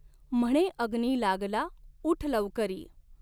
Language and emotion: Marathi, neutral